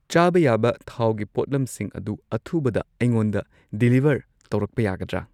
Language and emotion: Manipuri, neutral